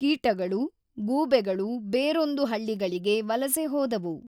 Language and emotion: Kannada, neutral